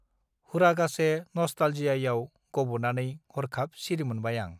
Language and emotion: Bodo, neutral